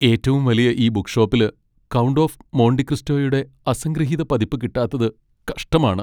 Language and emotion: Malayalam, sad